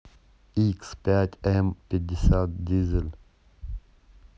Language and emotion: Russian, neutral